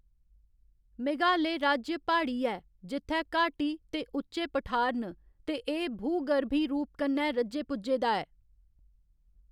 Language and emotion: Dogri, neutral